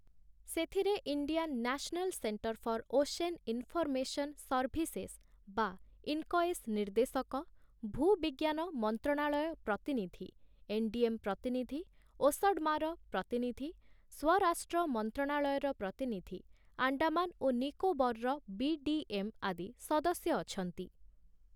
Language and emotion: Odia, neutral